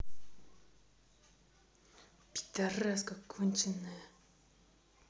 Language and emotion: Russian, angry